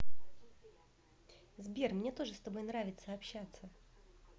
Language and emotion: Russian, positive